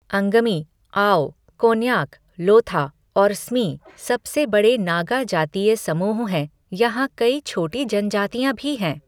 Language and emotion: Hindi, neutral